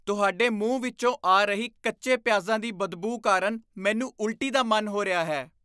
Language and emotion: Punjabi, disgusted